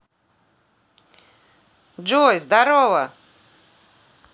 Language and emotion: Russian, positive